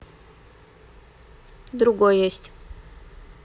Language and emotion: Russian, neutral